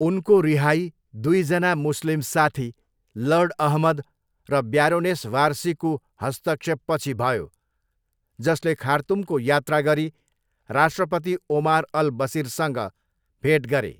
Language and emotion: Nepali, neutral